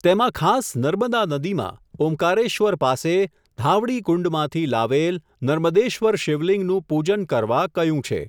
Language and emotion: Gujarati, neutral